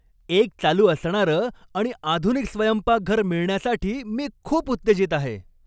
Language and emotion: Marathi, happy